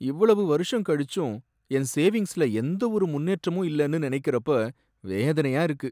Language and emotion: Tamil, sad